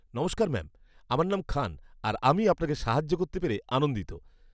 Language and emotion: Bengali, happy